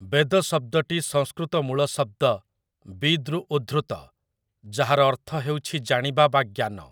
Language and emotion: Odia, neutral